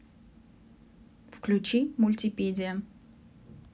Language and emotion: Russian, neutral